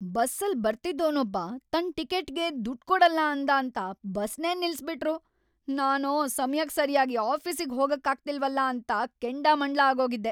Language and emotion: Kannada, angry